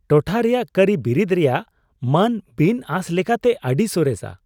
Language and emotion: Santali, surprised